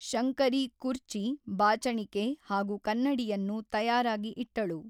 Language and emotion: Kannada, neutral